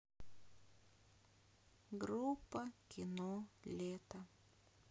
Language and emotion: Russian, sad